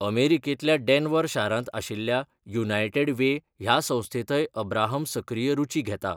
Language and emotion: Goan Konkani, neutral